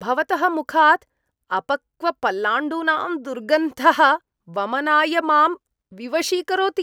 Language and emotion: Sanskrit, disgusted